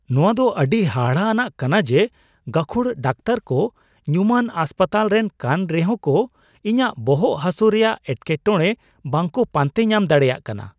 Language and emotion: Santali, surprised